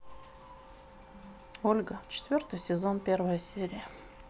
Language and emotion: Russian, neutral